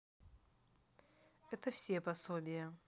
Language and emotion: Russian, neutral